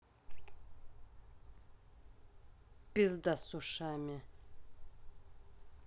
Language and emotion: Russian, angry